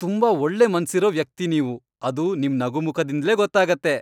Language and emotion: Kannada, happy